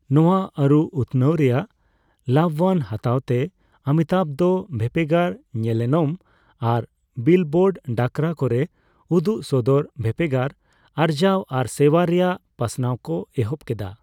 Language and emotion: Santali, neutral